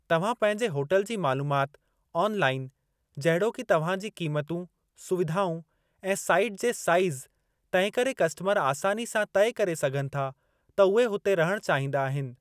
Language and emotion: Sindhi, neutral